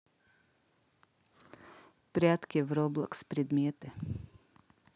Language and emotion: Russian, neutral